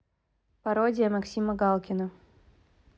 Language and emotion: Russian, neutral